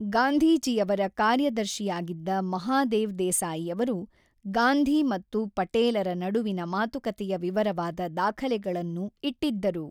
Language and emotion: Kannada, neutral